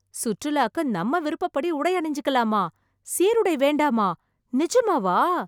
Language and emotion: Tamil, surprised